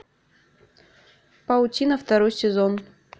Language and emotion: Russian, neutral